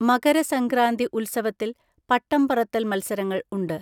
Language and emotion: Malayalam, neutral